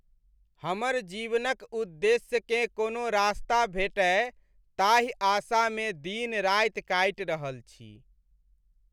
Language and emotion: Maithili, sad